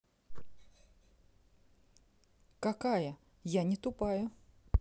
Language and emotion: Russian, neutral